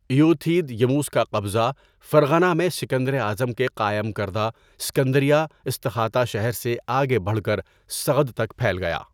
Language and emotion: Urdu, neutral